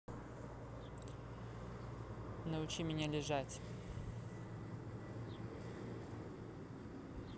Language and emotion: Russian, neutral